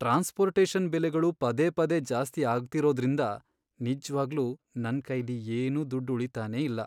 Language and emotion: Kannada, sad